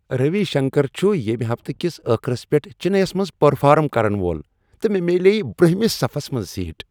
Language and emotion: Kashmiri, happy